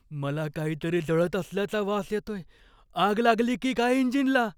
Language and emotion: Marathi, fearful